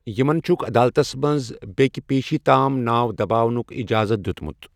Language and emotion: Kashmiri, neutral